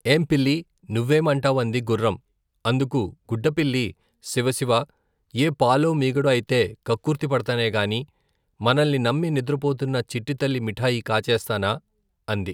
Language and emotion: Telugu, neutral